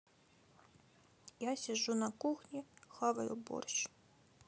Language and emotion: Russian, sad